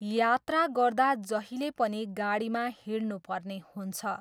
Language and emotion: Nepali, neutral